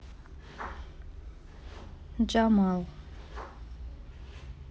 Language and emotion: Russian, neutral